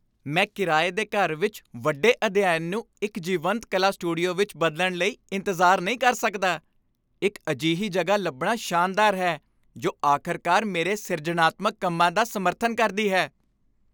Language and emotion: Punjabi, happy